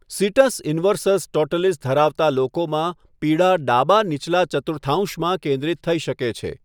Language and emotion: Gujarati, neutral